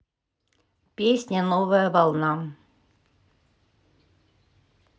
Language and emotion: Russian, neutral